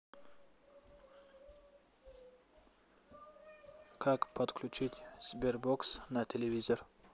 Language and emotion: Russian, neutral